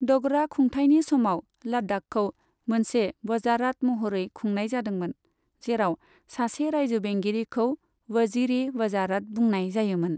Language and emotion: Bodo, neutral